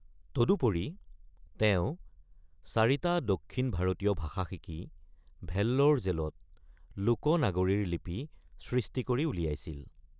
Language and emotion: Assamese, neutral